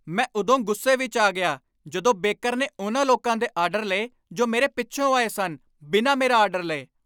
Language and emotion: Punjabi, angry